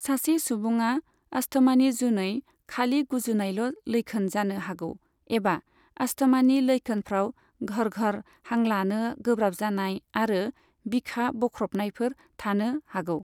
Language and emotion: Bodo, neutral